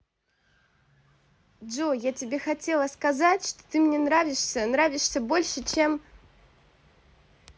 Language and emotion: Russian, positive